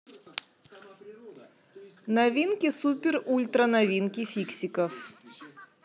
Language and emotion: Russian, neutral